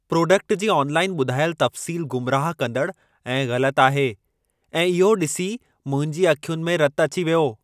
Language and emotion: Sindhi, angry